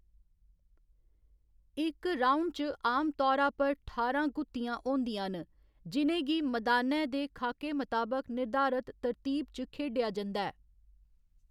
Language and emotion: Dogri, neutral